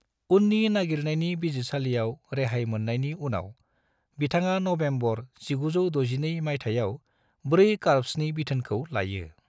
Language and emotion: Bodo, neutral